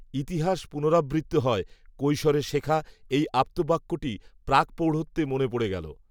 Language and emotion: Bengali, neutral